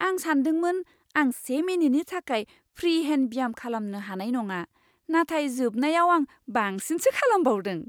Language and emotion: Bodo, surprised